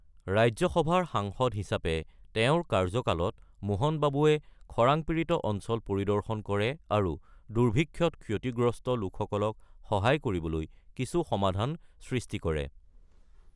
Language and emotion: Assamese, neutral